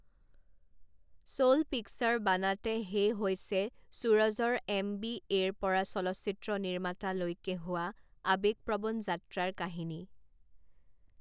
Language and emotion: Assamese, neutral